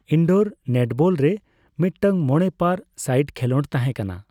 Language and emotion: Santali, neutral